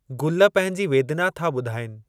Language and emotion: Sindhi, neutral